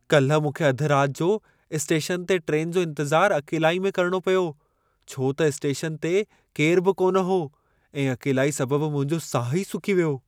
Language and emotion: Sindhi, fearful